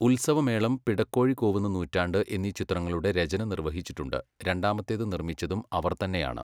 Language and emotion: Malayalam, neutral